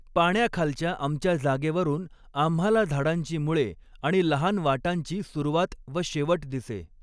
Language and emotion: Marathi, neutral